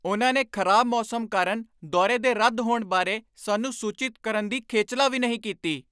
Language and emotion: Punjabi, angry